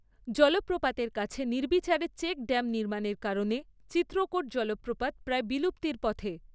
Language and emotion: Bengali, neutral